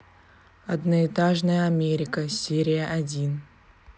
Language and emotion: Russian, neutral